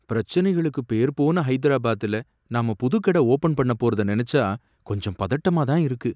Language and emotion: Tamil, fearful